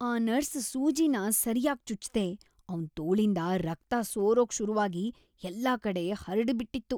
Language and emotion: Kannada, disgusted